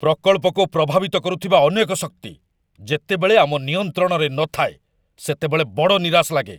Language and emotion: Odia, angry